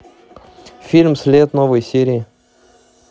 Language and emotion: Russian, neutral